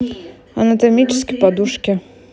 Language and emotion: Russian, neutral